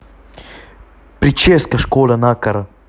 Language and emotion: Russian, neutral